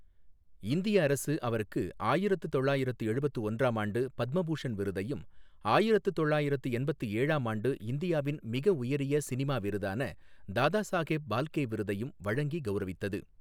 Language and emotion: Tamil, neutral